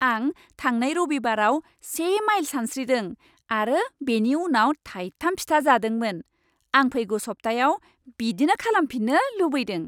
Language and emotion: Bodo, happy